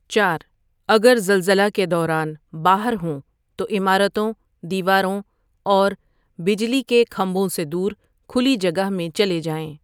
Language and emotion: Urdu, neutral